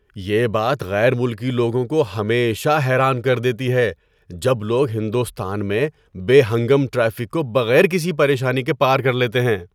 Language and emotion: Urdu, surprised